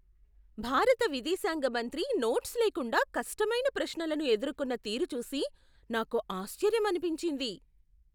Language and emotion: Telugu, surprised